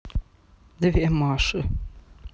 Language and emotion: Russian, neutral